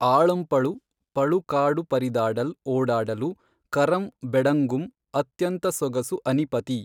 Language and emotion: Kannada, neutral